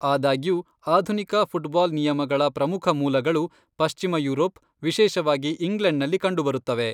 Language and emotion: Kannada, neutral